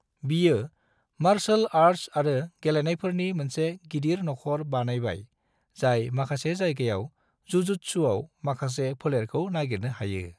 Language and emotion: Bodo, neutral